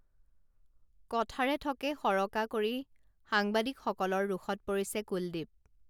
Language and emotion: Assamese, neutral